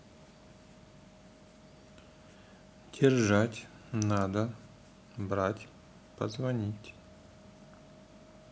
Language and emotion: Russian, neutral